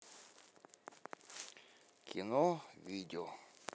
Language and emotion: Russian, neutral